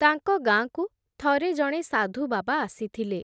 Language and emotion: Odia, neutral